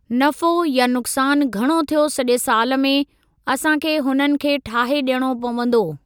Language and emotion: Sindhi, neutral